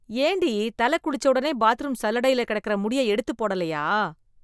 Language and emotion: Tamil, disgusted